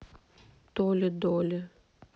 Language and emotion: Russian, sad